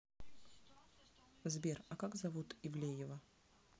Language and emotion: Russian, neutral